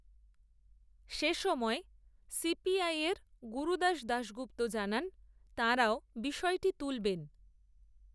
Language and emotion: Bengali, neutral